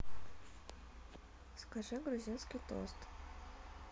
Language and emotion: Russian, neutral